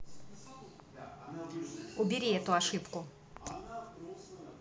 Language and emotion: Russian, neutral